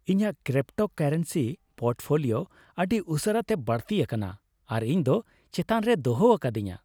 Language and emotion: Santali, happy